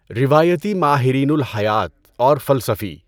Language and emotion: Urdu, neutral